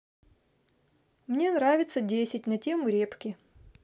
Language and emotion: Russian, neutral